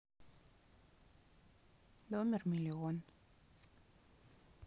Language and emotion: Russian, neutral